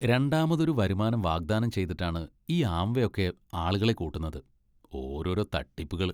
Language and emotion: Malayalam, disgusted